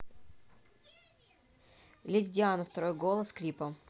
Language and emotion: Russian, neutral